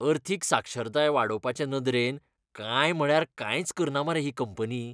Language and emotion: Goan Konkani, disgusted